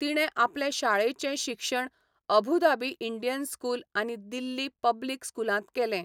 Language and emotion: Goan Konkani, neutral